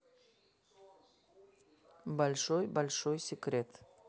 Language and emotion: Russian, neutral